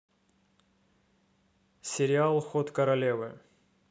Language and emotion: Russian, neutral